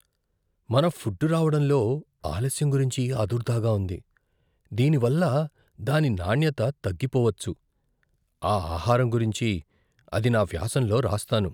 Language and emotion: Telugu, fearful